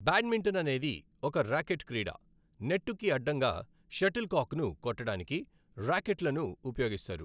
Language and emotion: Telugu, neutral